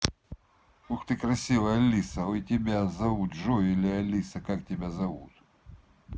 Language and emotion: Russian, positive